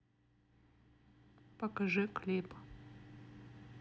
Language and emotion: Russian, neutral